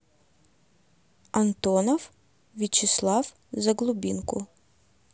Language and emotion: Russian, neutral